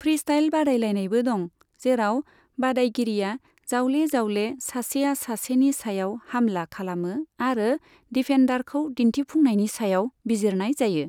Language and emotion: Bodo, neutral